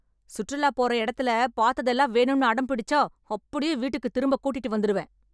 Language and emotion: Tamil, angry